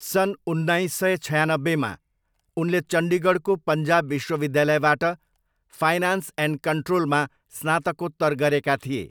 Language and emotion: Nepali, neutral